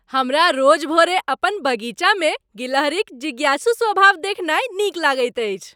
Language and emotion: Maithili, happy